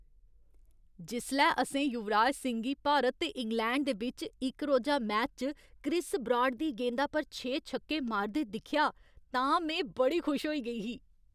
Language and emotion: Dogri, happy